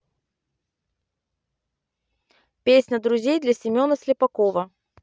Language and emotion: Russian, neutral